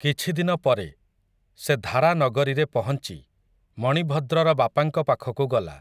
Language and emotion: Odia, neutral